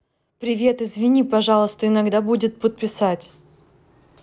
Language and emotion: Russian, neutral